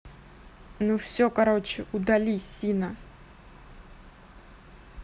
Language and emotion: Russian, angry